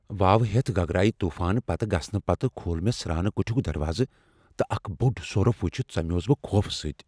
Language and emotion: Kashmiri, fearful